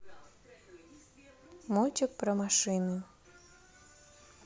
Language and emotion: Russian, neutral